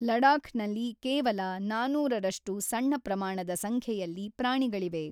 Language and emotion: Kannada, neutral